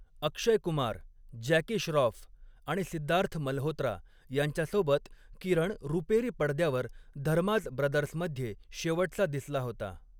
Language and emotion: Marathi, neutral